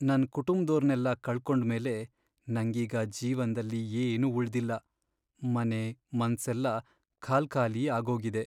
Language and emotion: Kannada, sad